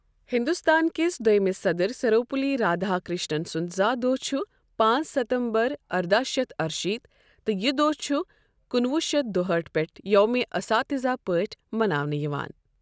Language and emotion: Kashmiri, neutral